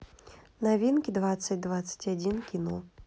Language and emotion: Russian, neutral